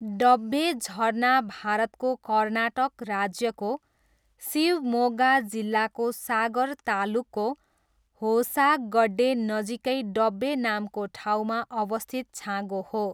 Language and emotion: Nepali, neutral